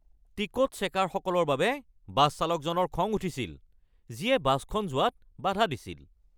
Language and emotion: Assamese, angry